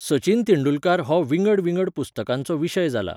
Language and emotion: Goan Konkani, neutral